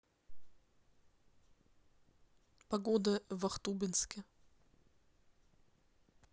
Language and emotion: Russian, neutral